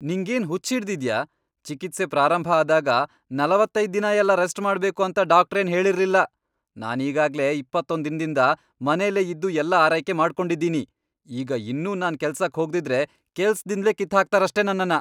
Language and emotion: Kannada, angry